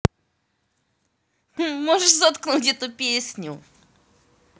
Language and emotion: Russian, positive